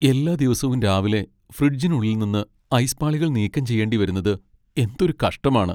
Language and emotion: Malayalam, sad